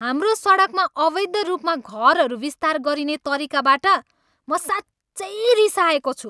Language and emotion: Nepali, angry